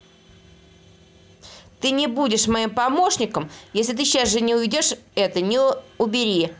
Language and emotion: Russian, angry